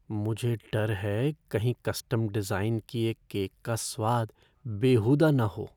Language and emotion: Hindi, fearful